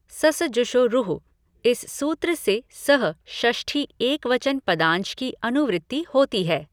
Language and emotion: Hindi, neutral